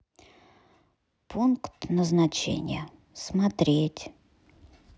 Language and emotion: Russian, sad